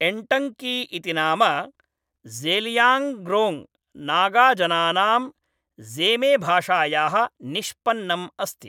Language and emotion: Sanskrit, neutral